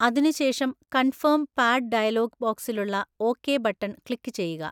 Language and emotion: Malayalam, neutral